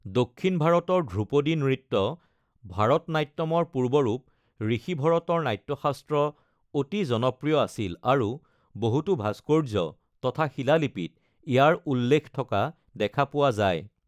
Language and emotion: Assamese, neutral